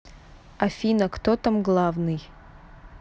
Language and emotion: Russian, neutral